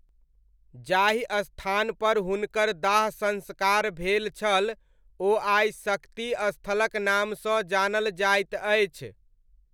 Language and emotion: Maithili, neutral